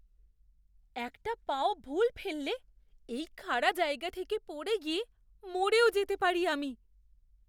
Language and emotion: Bengali, fearful